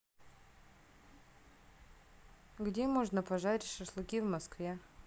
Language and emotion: Russian, neutral